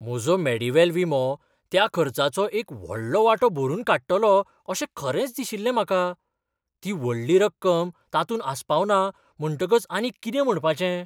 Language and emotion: Goan Konkani, surprised